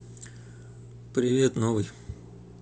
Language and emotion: Russian, neutral